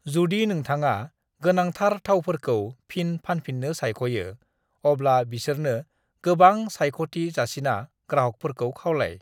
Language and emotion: Bodo, neutral